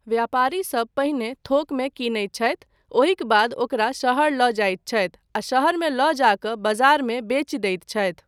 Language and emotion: Maithili, neutral